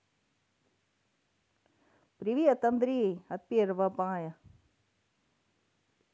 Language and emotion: Russian, positive